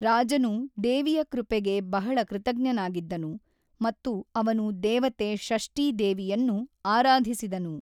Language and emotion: Kannada, neutral